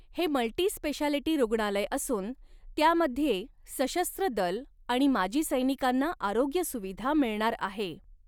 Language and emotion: Marathi, neutral